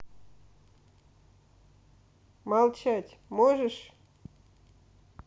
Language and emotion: Russian, neutral